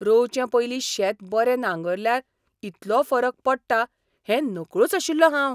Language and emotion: Goan Konkani, surprised